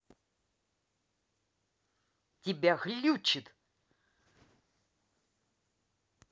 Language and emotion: Russian, angry